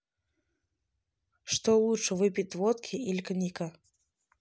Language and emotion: Russian, neutral